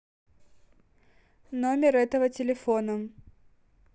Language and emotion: Russian, neutral